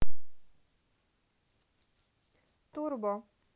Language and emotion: Russian, neutral